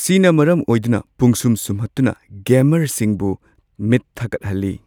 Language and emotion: Manipuri, neutral